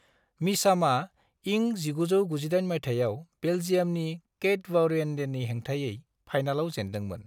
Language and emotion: Bodo, neutral